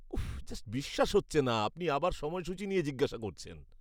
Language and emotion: Bengali, disgusted